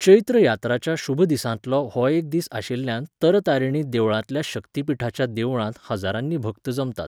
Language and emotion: Goan Konkani, neutral